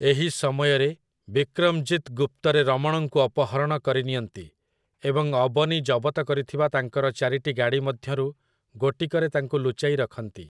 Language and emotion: Odia, neutral